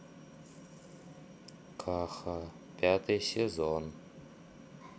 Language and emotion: Russian, sad